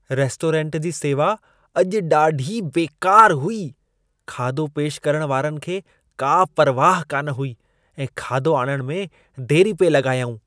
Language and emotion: Sindhi, disgusted